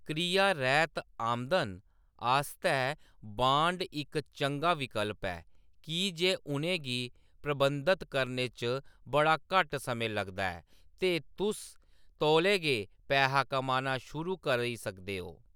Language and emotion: Dogri, neutral